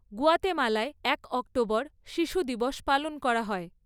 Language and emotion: Bengali, neutral